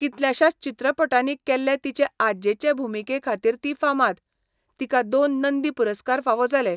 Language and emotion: Goan Konkani, neutral